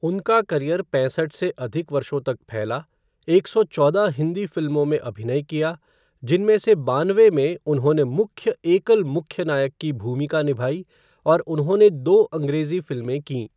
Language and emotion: Hindi, neutral